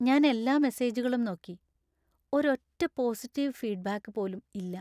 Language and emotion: Malayalam, sad